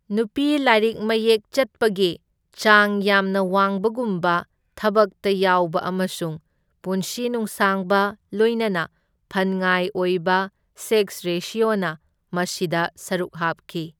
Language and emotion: Manipuri, neutral